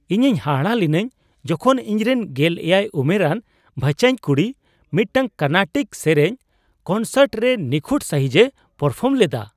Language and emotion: Santali, surprised